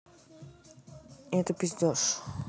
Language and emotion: Russian, neutral